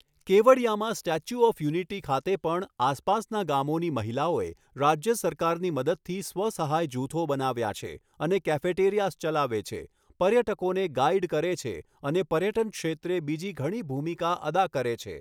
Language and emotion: Gujarati, neutral